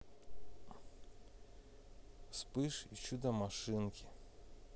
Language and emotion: Russian, sad